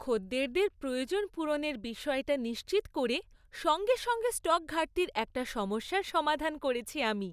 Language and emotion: Bengali, happy